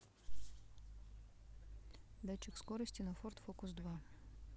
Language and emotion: Russian, neutral